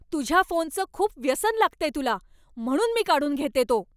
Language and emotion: Marathi, angry